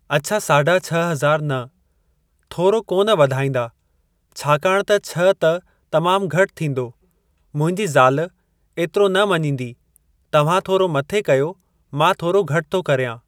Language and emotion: Sindhi, neutral